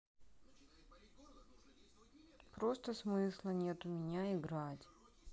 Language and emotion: Russian, sad